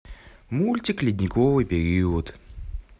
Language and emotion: Russian, neutral